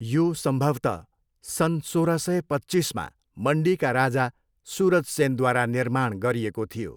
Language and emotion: Nepali, neutral